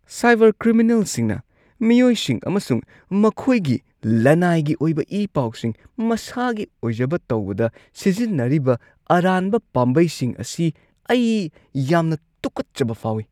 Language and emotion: Manipuri, disgusted